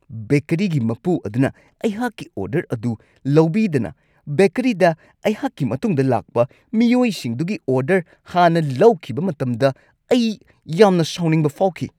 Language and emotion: Manipuri, angry